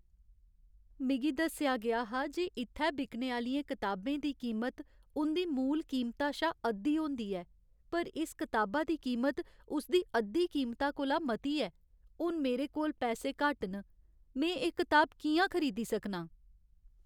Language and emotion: Dogri, sad